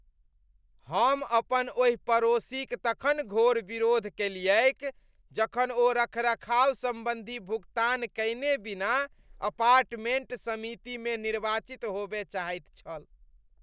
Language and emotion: Maithili, disgusted